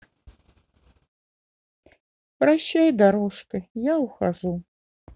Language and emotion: Russian, sad